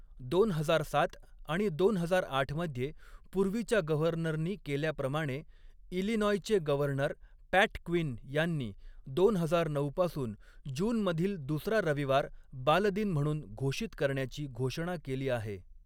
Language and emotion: Marathi, neutral